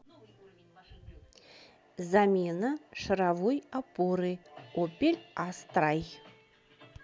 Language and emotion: Russian, neutral